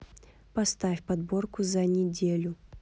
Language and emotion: Russian, neutral